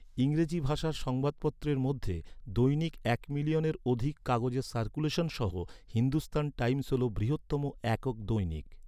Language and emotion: Bengali, neutral